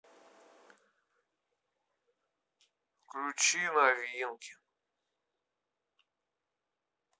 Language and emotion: Russian, sad